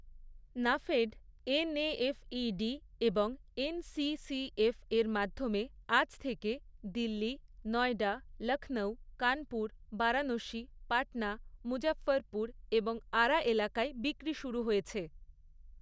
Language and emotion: Bengali, neutral